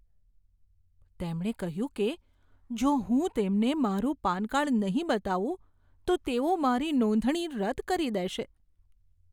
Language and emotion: Gujarati, fearful